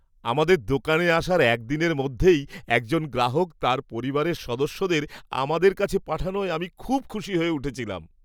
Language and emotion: Bengali, happy